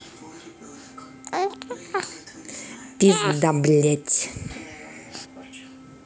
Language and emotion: Russian, angry